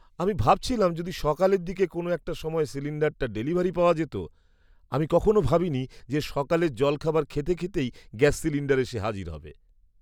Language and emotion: Bengali, surprised